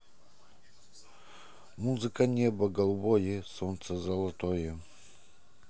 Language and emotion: Russian, positive